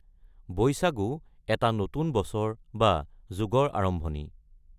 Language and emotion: Assamese, neutral